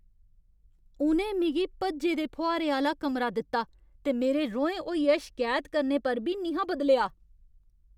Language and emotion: Dogri, angry